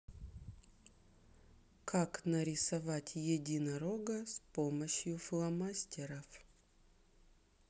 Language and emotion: Russian, neutral